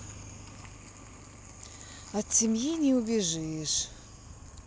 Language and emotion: Russian, sad